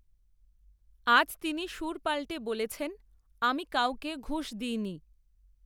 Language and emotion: Bengali, neutral